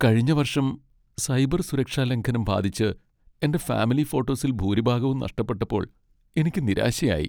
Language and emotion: Malayalam, sad